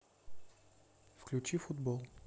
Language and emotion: Russian, neutral